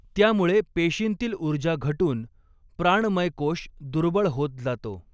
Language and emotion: Marathi, neutral